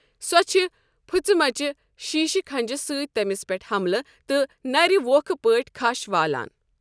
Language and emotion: Kashmiri, neutral